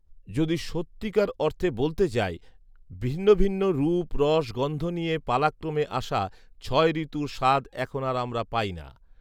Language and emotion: Bengali, neutral